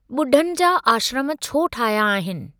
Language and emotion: Sindhi, neutral